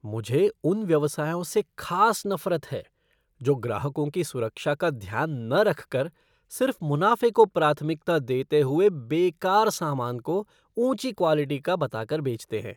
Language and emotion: Hindi, disgusted